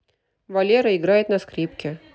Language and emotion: Russian, neutral